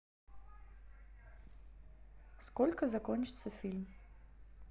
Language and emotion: Russian, neutral